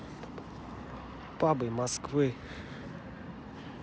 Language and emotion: Russian, neutral